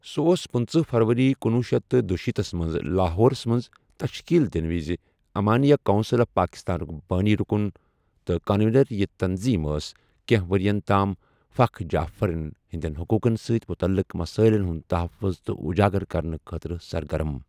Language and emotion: Kashmiri, neutral